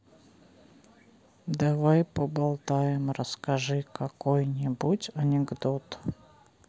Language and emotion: Russian, neutral